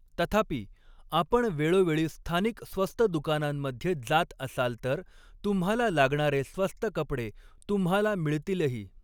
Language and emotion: Marathi, neutral